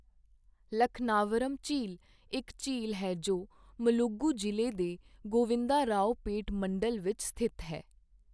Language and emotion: Punjabi, neutral